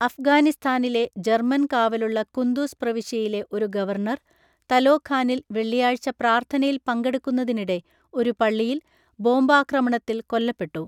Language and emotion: Malayalam, neutral